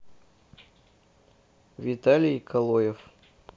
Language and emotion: Russian, neutral